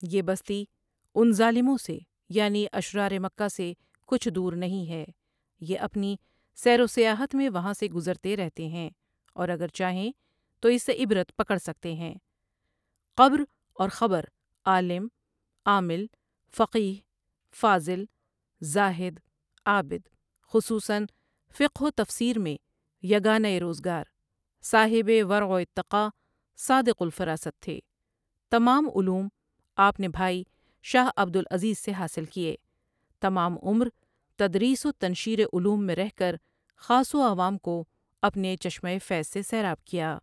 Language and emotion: Urdu, neutral